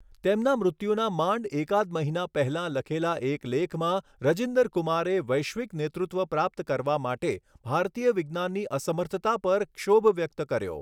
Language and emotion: Gujarati, neutral